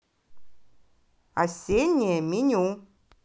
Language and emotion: Russian, positive